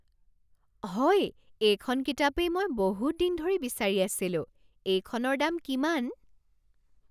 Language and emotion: Assamese, surprised